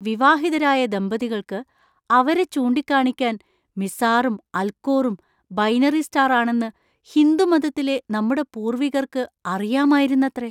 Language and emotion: Malayalam, surprised